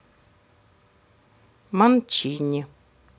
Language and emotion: Russian, neutral